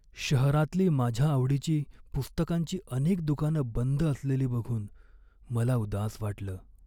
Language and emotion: Marathi, sad